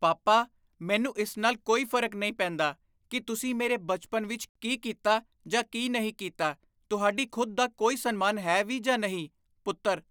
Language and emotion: Punjabi, disgusted